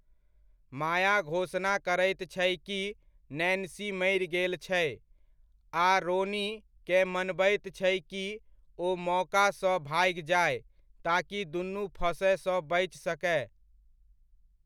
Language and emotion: Maithili, neutral